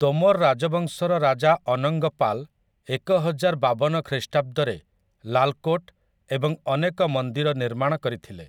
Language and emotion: Odia, neutral